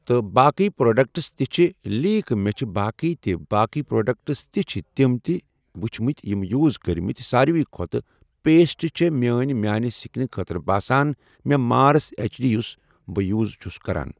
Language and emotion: Kashmiri, neutral